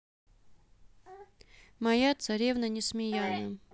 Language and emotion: Russian, neutral